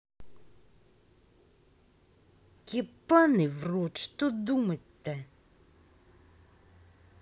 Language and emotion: Russian, angry